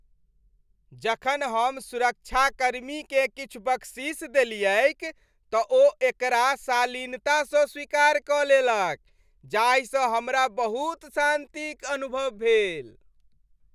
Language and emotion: Maithili, happy